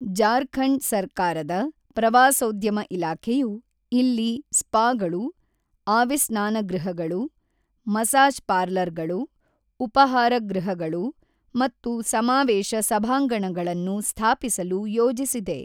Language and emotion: Kannada, neutral